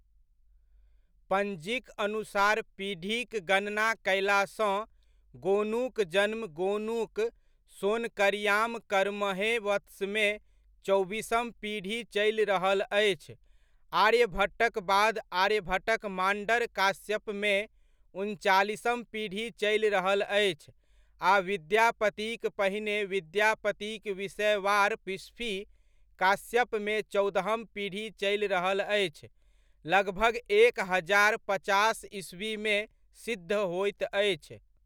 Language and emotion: Maithili, neutral